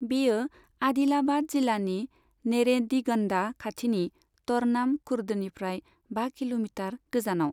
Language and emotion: Bodo, neutral